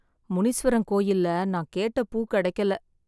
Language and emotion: Tamil, sad